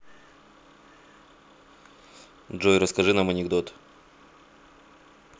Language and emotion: Russian, neutral